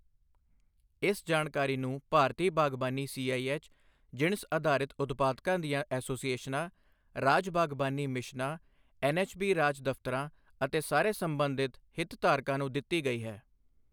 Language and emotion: Punjabi, neutral